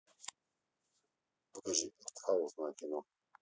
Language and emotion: Russian, neutral